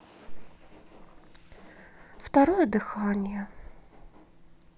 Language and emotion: Russian, sad